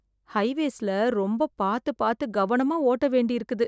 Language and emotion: Tamil, fearful